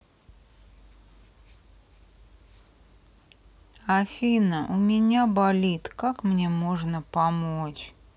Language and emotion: Russian, sad